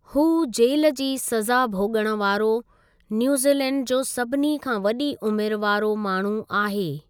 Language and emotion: Sindhi, neutral